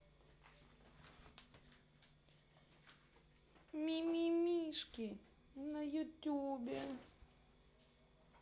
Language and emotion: Russian, sad